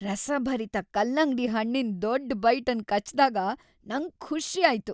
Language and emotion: Kannada, happy